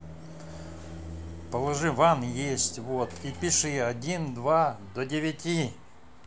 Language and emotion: Russian, angry